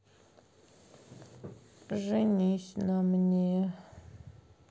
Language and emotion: Russian, sad